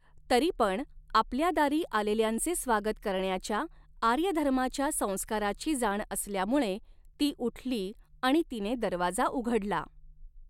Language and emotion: Marathi, neutral